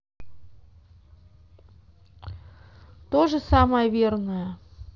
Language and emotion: Russian, neutral